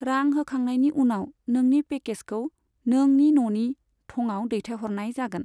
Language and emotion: Bodo, neutral